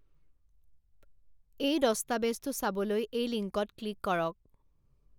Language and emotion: Assamese, neutral